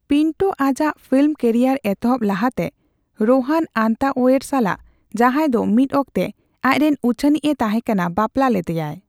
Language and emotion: Santali, neutral